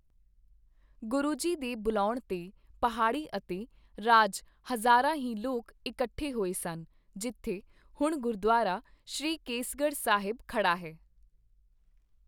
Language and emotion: Punjabi, neutral